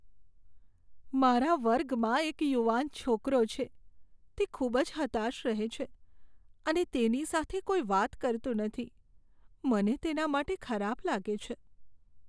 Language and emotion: Gujarati, sad